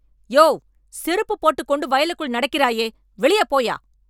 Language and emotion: Tamil, angry